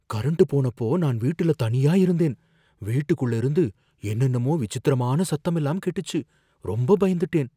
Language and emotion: Tamil, fearful